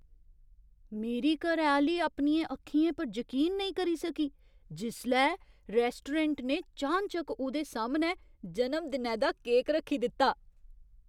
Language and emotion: Dogri, surprised